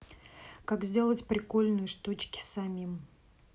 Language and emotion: Russian, neutral